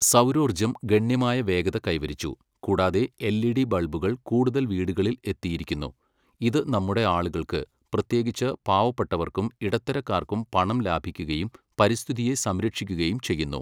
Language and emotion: Malayalam, neutral